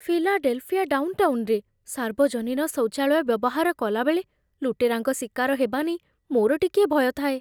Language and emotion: Odia, fearful